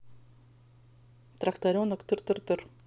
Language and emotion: Russian, neutral